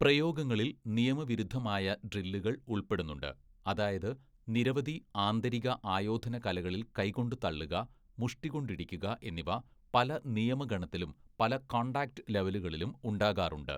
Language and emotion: Malayalam, neutral